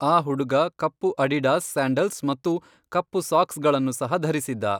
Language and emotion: Kannada, neutral